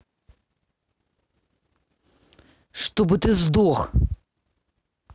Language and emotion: Russian, angry